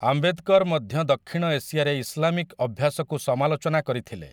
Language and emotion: Odia, neutral